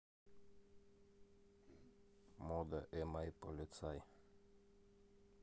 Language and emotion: Russian, neutral